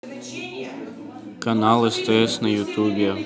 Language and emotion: Russian, neutral